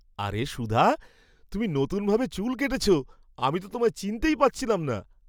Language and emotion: Bengali, surprised